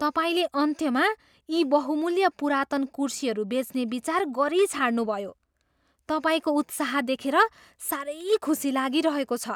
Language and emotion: Nepali, surprised